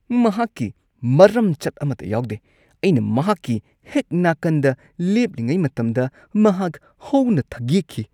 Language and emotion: Manipuri, disgusted